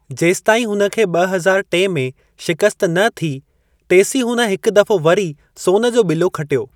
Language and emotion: Sindhi, neutral